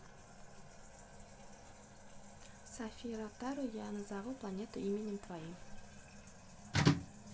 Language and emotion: Russian, neutral